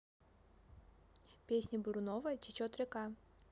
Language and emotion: Russian, neutral